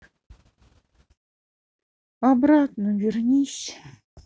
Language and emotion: Russian, sad